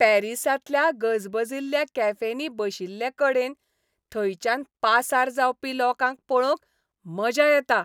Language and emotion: Goan Konkani, happy